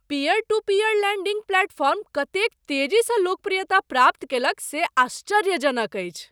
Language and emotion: Maithili, surprised